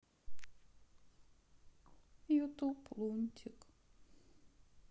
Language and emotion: Russian, sad